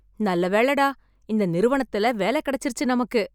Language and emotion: Tamil, happy